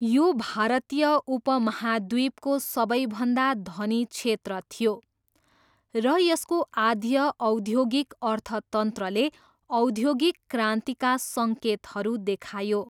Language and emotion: Nepali, neutral